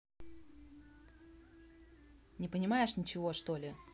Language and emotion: Russian, angry